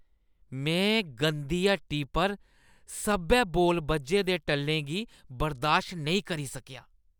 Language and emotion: Dogri, disgusted